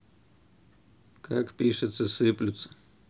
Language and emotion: Russian, neutral